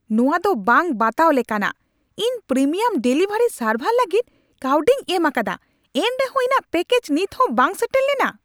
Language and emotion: Santali, angry